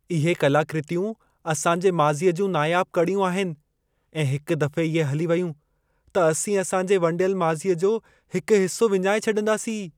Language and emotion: Sindhi, fearful